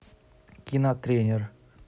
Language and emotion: Russian, neutral